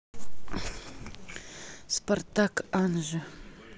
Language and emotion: Russian, neutral